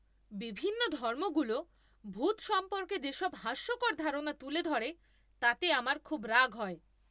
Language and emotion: Bengali, angry